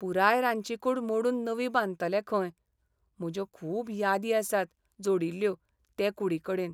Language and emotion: Goan Konkani, sad